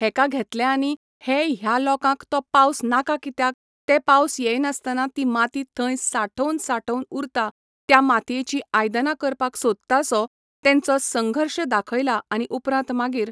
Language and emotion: Goan Konkani, neutral